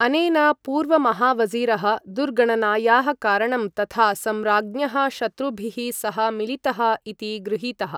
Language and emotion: Sanskrit, neutral